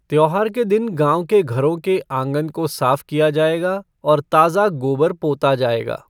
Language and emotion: Hindi, neutral